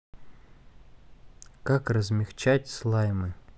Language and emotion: Russian, neutral